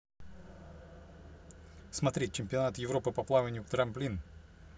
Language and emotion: Russian, neutral